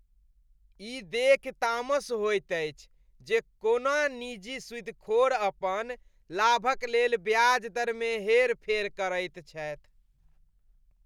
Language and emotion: Maithili, disgusted